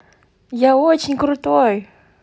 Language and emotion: Russian, positive